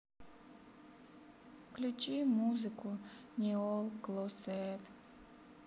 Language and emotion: Russian, sad